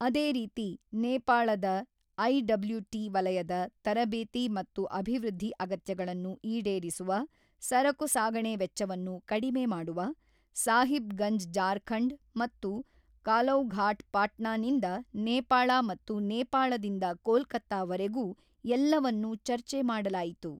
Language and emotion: Kannada, neutral